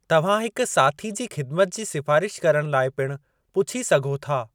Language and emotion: Sindhi, neutral